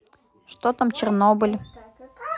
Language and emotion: Russian, neutral